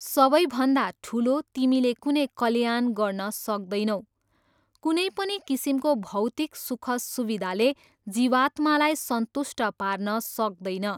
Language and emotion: Nepali, neutral